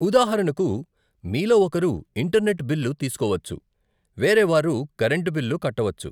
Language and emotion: Telugu, neutral